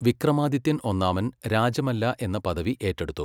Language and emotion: Malayalam, neutral